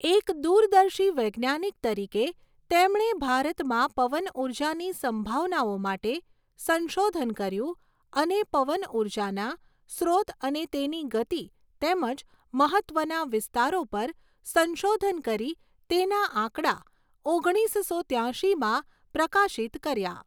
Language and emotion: Gujarati, neutral